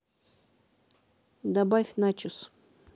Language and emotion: Russian, neutral